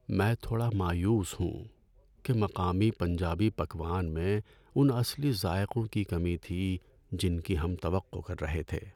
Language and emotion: Urdu, sad